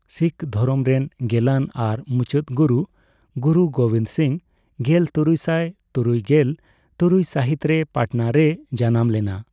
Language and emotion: Santali, neutral